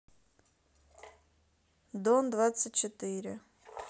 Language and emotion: Russian, neutral